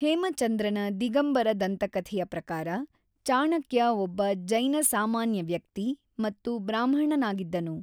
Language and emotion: Kannada, neutral